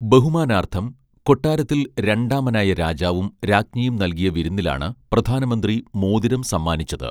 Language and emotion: Malayalam, neutral